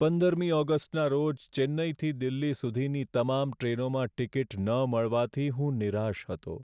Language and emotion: Gujarati, sad